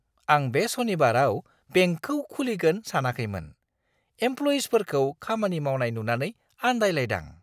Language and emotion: Bodo, surprised